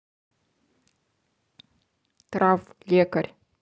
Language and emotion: Russian, neutral